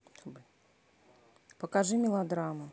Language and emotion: Russian, neutral